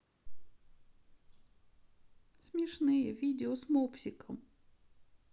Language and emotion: Russian, sad